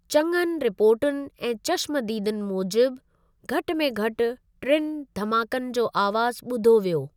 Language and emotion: Sindhi, neutral